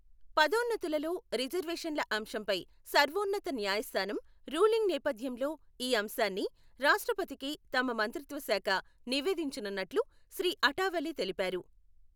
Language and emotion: Telugu, neutral